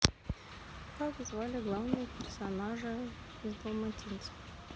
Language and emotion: Russian, neutral